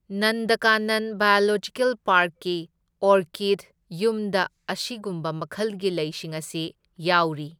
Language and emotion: Manipuri, neutral